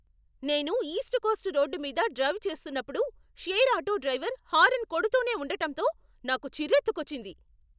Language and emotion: Telugu, angry